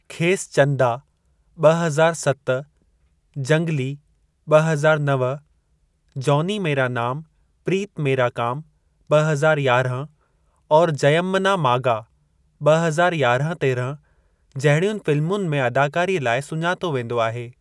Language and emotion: Sindhi, neutral